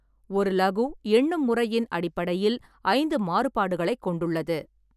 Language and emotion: Tamil, neutral